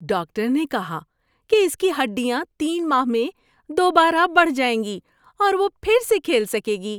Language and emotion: Urdu, happy